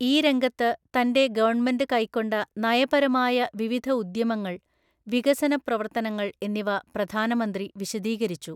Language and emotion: Malayalam, neutral